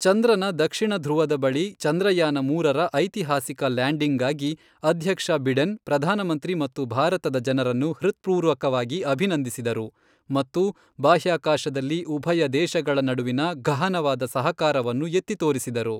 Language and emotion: Kannada, neutral